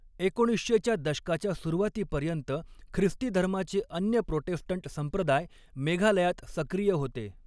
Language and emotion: Marathi, neutral